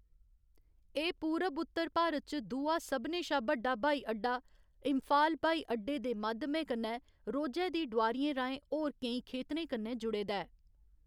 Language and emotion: Dogri, neutral